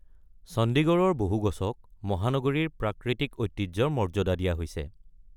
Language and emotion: Assamese, neutral